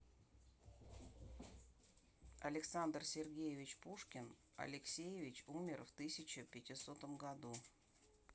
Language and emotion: Russian, neutral